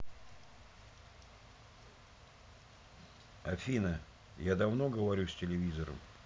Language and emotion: Russian, neutral